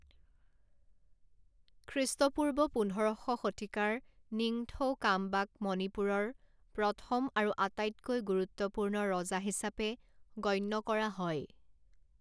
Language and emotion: Assamese, neutral